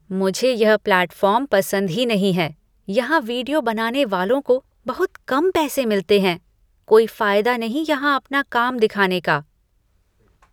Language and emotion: Hindi, disgusted